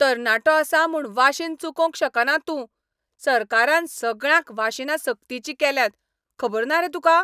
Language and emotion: Goan Konkani, angry